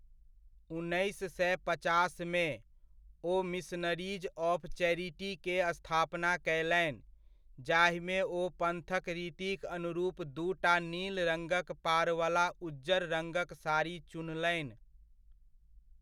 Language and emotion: Maithili, neutral